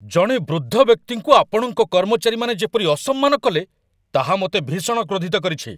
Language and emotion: Odia, angry